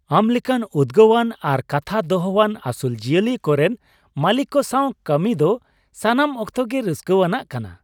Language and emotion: Santali, happy